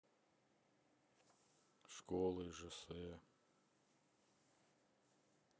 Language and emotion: Russian, sad